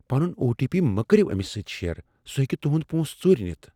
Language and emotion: Kashmiri, fearful